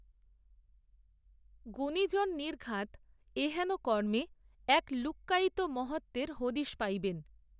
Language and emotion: Bengali, neutral